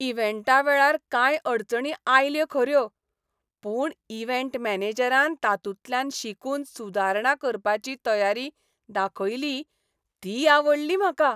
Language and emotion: Goan Konkani, happy